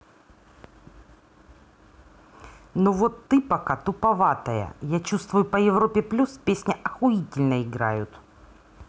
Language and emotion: Russian, angry